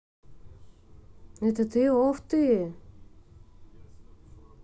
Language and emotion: Russian, neutral